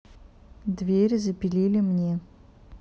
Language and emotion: Russian, neutral